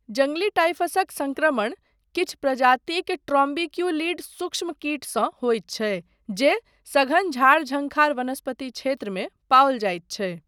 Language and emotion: Maithili, neutral